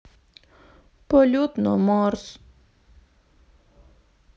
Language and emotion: Russian, sad